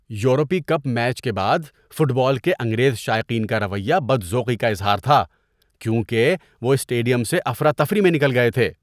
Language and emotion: Urdu, disgusted